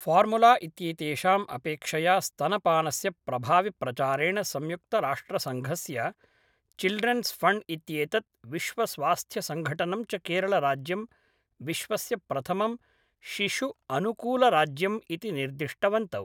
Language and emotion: Sanskrit, neutral